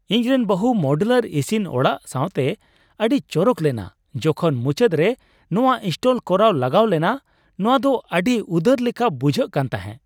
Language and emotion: Santali, happy